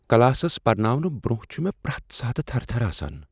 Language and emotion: Kashmiri, fearful